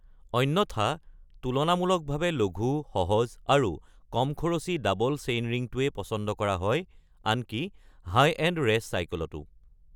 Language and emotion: Assamese, neutral